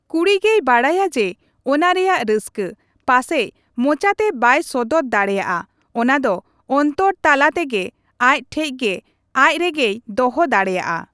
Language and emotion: Santali, neutral